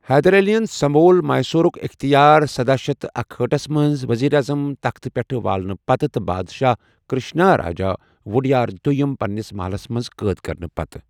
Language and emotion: Kashmiri, neutral